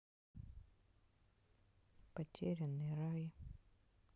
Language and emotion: Russian, sad